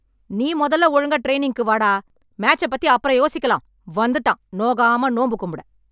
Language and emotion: Tamil, angry